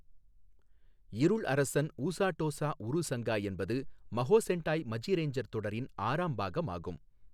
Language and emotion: Tamil, neutral